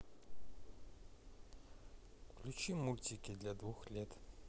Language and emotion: Russian, neutral